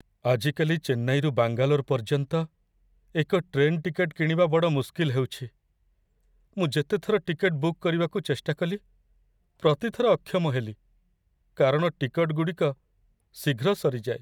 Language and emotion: Odia, sad